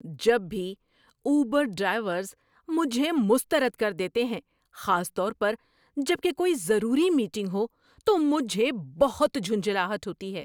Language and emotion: Urdu, angry